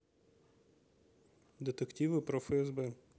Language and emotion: Russian, neutral